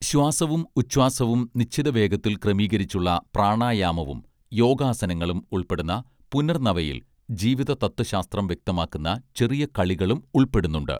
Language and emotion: Malayalam, neutral